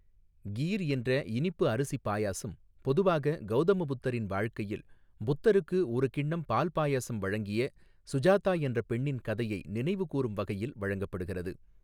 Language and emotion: Tamil, neutral